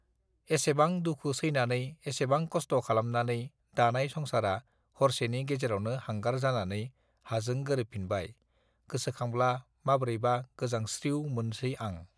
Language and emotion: Bodo, neutral